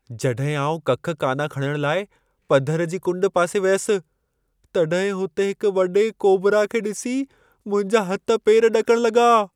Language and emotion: Sindhi, fearful